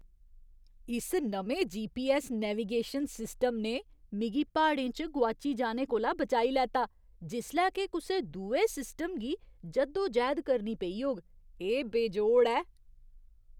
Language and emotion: Dogri, surprised